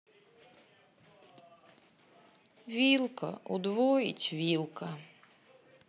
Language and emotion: Russian, sad